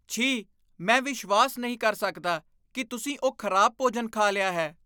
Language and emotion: Punjabi, disgusted